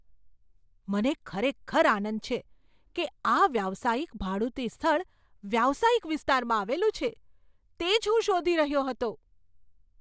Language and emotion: Gujarati, surprised